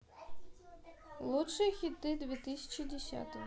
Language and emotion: Russian, neutral